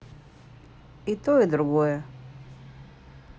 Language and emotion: Russian, neutral